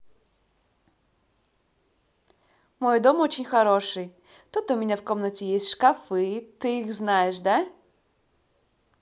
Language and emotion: Russian, positive